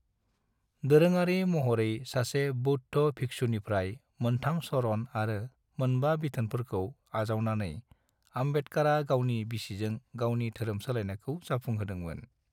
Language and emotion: Bodo, neutral